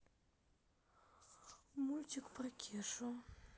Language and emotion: Russian, sad